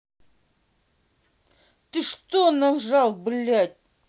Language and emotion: Russian, angry